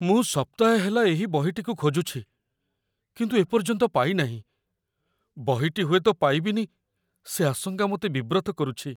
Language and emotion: Odia, fearful